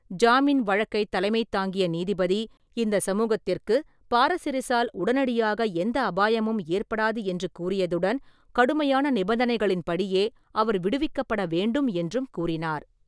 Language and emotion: Tamil, neutral